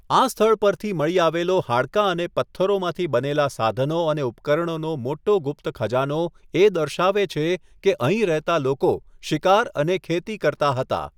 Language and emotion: Gujarati, neutral